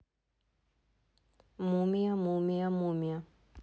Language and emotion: Russian, neutral